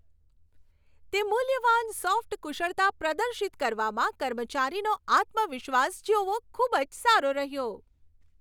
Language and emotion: Gujarati, happy